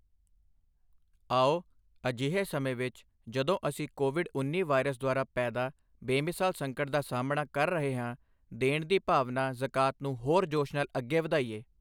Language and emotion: Punjabi, neutral